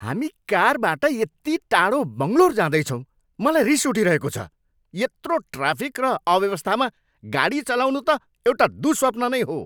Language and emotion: Nepali, angry